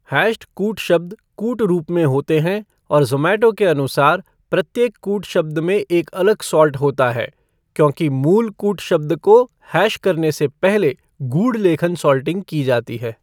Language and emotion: Hindi, neutral